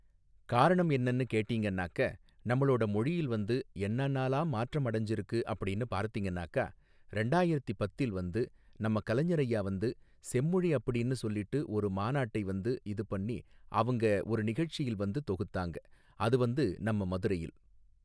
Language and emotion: Tamil, neutral